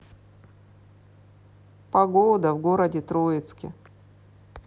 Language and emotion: Russian, sad